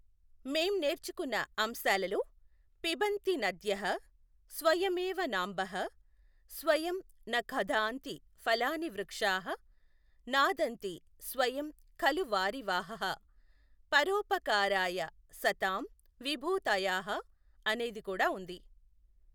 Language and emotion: Telugu, neutral